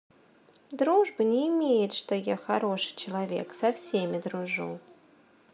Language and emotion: Russian, neutral